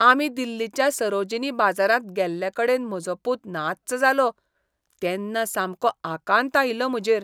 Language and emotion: Goan Konkani, disgusted